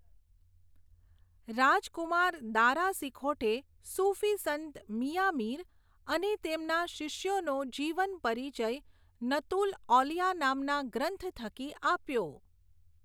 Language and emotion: Gujarati, neutral